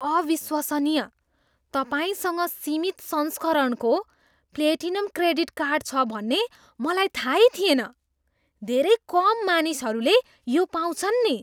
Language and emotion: Nepali, surprised